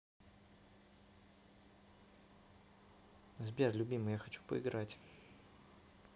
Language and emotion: Russian, neutral